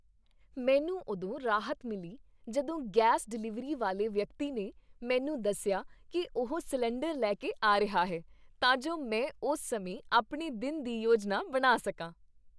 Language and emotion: Punjabi, happy